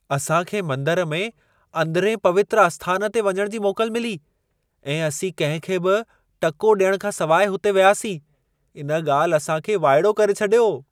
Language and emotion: Sindhi, surprised